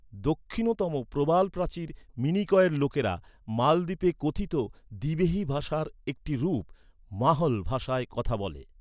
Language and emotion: Bengali, neutral